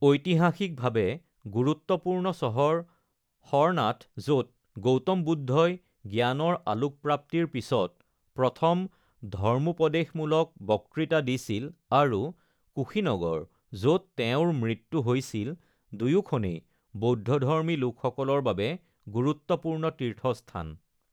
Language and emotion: Assamese, neutral